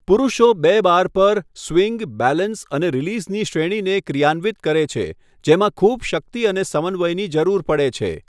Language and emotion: Gujarati, neutral